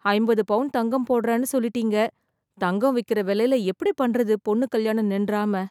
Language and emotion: Tamil, fearful